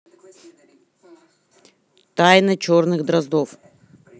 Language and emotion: Russian, neutral